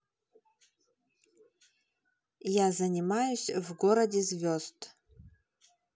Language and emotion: Russian, neutral